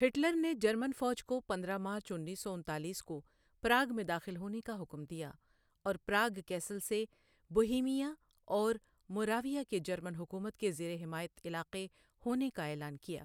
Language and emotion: Urdu, neutral